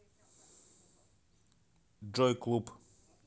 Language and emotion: Russian, neutral